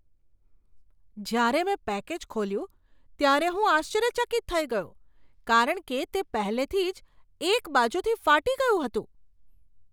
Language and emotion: Gujarati, surprised